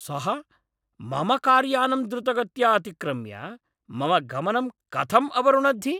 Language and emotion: Sanskrit, angry